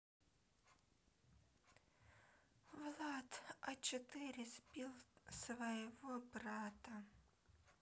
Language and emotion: Russian, sad